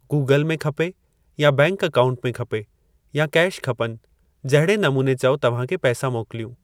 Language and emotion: Sindhi, neutral